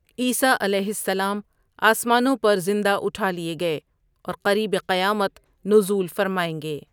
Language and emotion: Urdu, neutral